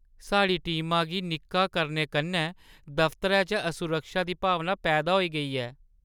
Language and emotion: Dogri, sad